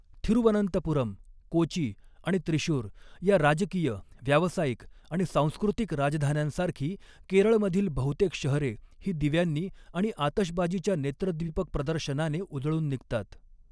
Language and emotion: Marathi, neutral